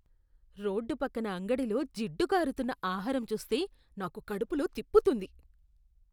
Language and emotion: Telugu, disgusted